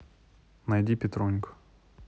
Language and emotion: Russian, neutral